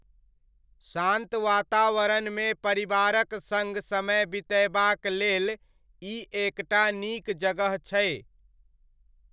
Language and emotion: Maithili, neutral